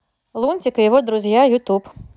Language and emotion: Russian, neutral